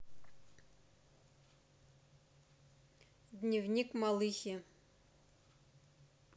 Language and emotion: Russian, neutral